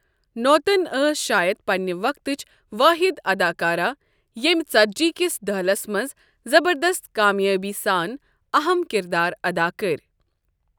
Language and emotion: Kashmiri, neutral